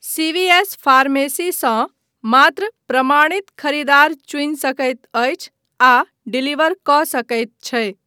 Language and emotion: Maithili, neutral